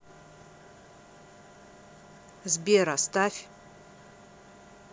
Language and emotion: Russian, neutral